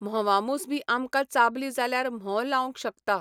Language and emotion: Goan Konkani, neutral